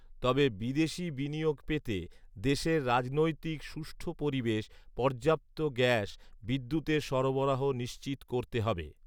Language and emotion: Bengali, neutral